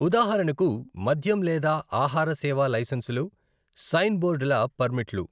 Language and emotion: Telugu, neutral